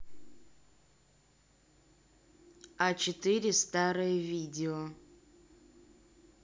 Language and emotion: Russian, neutral